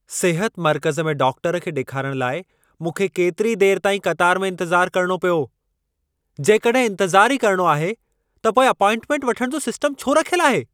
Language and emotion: Sindhi, angry